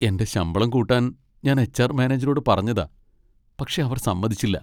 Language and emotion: Malayalam, sad